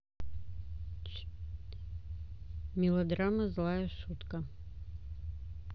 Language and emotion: Russian, neutral